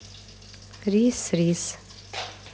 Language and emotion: Russian, neutral